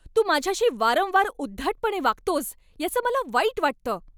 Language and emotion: Marathi, angry